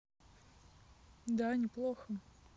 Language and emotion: Russian, neutral